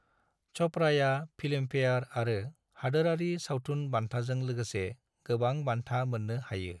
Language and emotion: Bodo, neutral